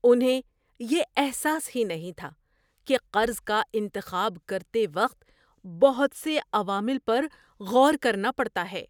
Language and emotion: Urdu, surprised